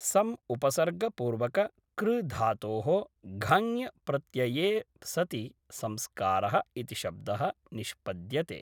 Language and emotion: Sanskrit, neutral